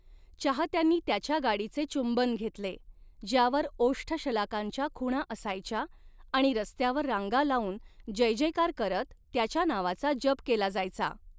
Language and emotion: Marathi, neutral